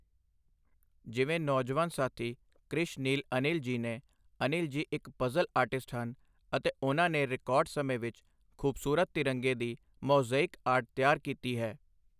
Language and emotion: Punjabi, neutral